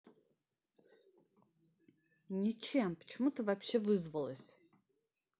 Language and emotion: Russian, angry